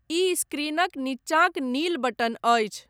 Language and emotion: Maithili, neutral